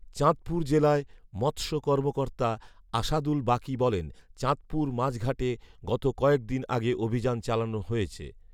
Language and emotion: Bengali, neutral